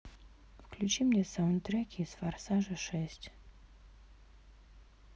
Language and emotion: Russian, neutral